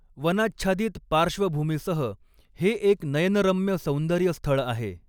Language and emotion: Marathi, neutral